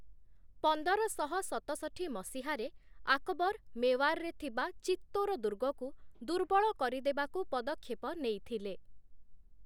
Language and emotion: Odia, neutral